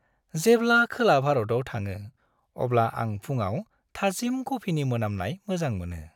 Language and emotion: Bodo, happy